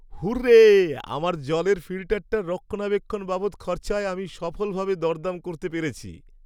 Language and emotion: Bengali, happy